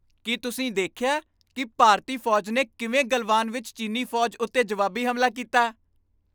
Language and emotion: Punjabi, happy